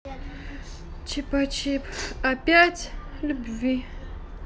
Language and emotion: Russian, sad